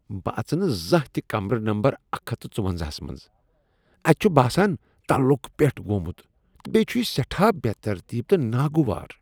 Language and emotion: Kashmiri, disgusted